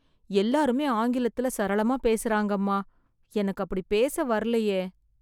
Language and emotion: Tamil, sad